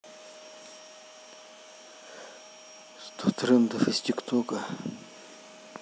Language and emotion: Russian, neutral